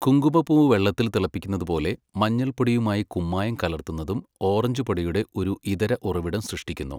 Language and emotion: Malayalam, neutral